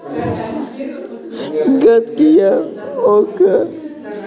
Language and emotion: Russian, sad